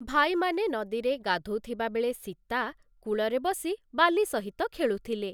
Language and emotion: Odia, neutral